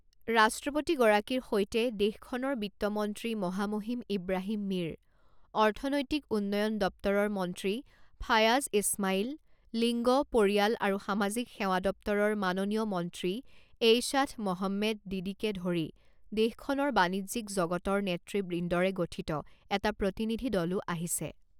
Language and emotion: Assamese, neutral